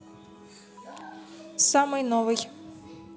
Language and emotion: Russian, neutral